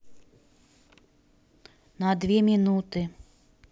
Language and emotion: Russian, neutral